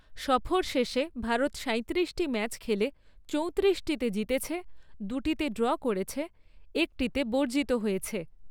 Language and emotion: Bengali, neutral